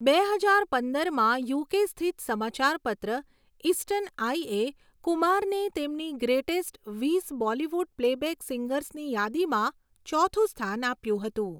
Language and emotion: Gujarati, neutral